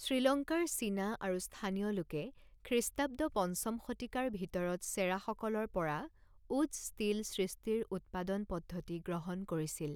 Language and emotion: Assamese, neutral